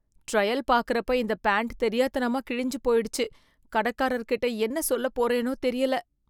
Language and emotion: Tamil, fearful